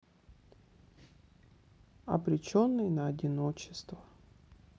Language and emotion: Russian, sad